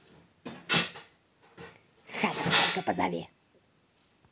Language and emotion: Russian, angry